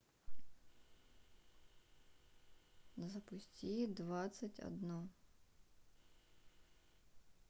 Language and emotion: Russian, sad